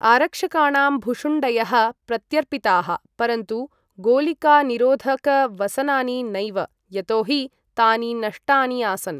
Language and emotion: Sanskrit, neutral